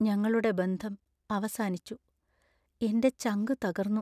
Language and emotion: Malayalam, sad